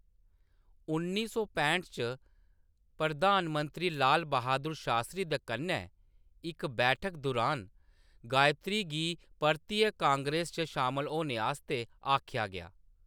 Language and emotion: Dogri, neutral